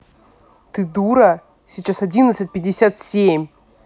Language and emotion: Russian, angry